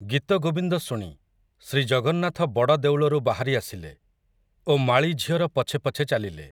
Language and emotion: Odia, neutral